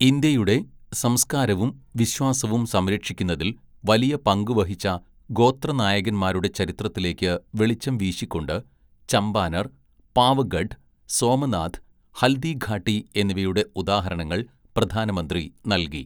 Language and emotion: Malayalam, neutral